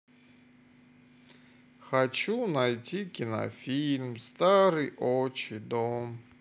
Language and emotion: Russian, sad